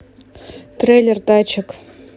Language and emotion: Russian, neutral